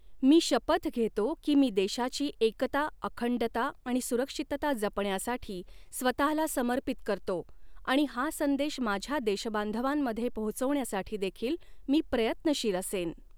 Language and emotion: Marathi, neutral